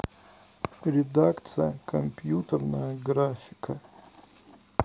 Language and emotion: Russian, neutral